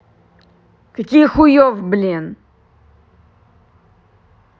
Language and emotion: Russian, angry